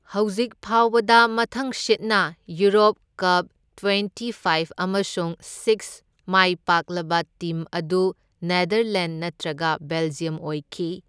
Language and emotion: Manipuri, neutral